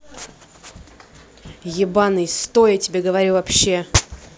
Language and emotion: Russian, angry